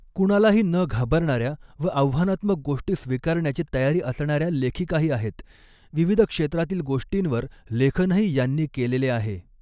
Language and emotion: Marathi, neutral